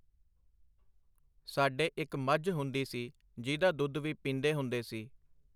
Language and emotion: Punjabi, neutral